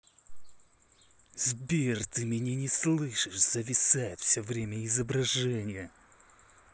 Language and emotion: Russian, angry